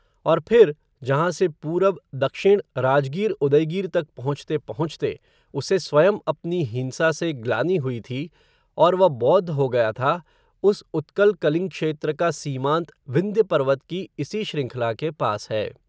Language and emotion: Hindi, neutral